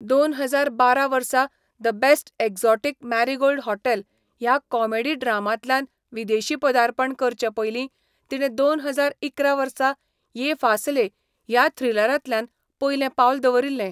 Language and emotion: Goan Konkani, neutral